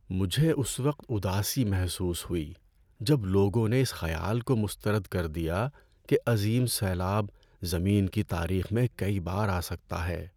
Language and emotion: Urdu, sad